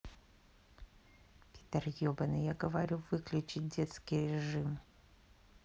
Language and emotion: Russian, angry